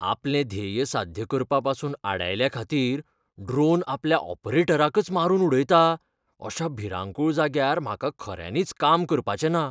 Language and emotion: Goan Konkani, fearful